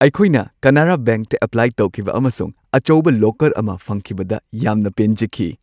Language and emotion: Manipuri, happy